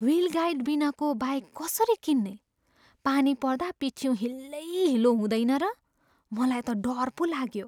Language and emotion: Nepali, fearful